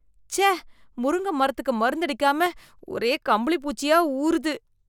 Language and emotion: Tamil, disgusted